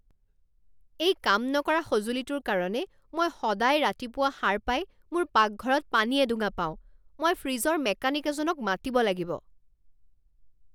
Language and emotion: Assamese, angry